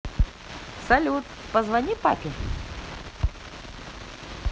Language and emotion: Russian, positive